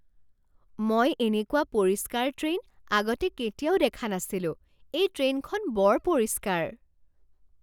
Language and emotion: Assamese, surprised